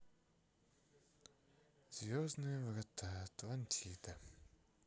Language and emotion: Russian, sad